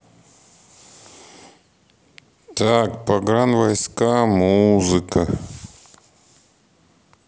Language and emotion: Russian, neutral